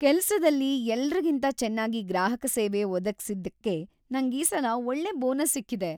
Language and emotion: Kannada, happy